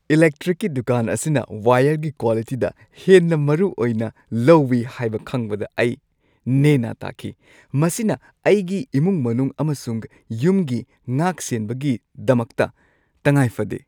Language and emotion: Manipuri, happy